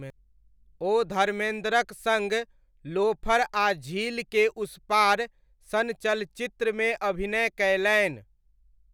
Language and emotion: Maithili, neutral